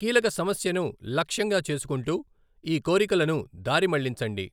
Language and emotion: Telugu, neutral